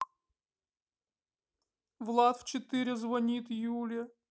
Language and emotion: Russian, sad